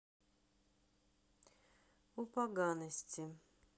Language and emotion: Russian, neutral